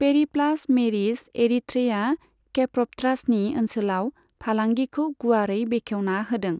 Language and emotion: Bodo, neutral